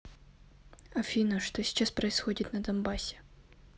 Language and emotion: Russian, neutral